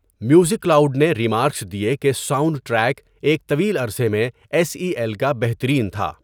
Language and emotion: Urdu, neutral